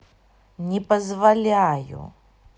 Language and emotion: Russian, angry